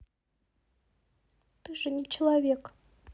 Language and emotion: Russian, sad